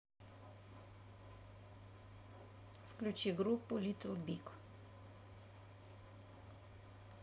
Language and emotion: Russian, neutral